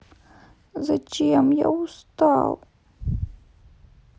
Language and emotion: Russian, sad